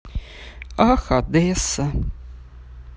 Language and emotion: Russian, sad